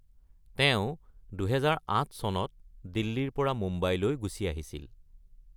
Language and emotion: Assamese, neutral